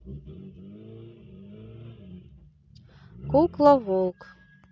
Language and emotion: Russian, neutral